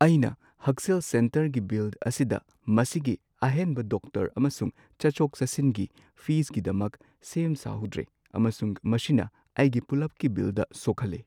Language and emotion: Manipuri, sad